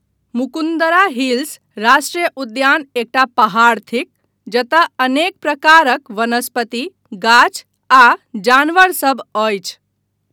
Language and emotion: Maithili, neutral